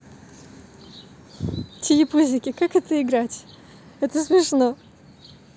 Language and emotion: Russian, positive